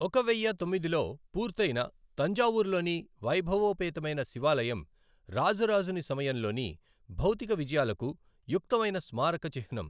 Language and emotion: Telugu, neutral